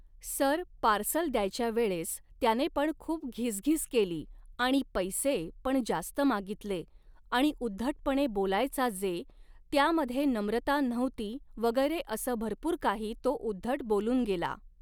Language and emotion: Marathi, neutral